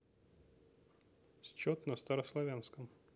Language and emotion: Russian, neutral